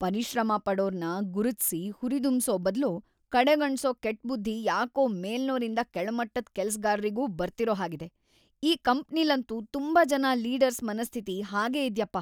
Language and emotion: Kannada, disgusted